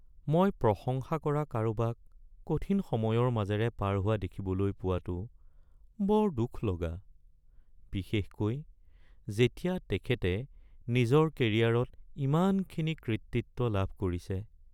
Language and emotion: Assamese, sad